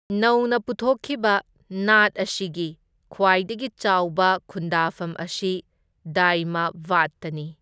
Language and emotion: Manipuri, neutral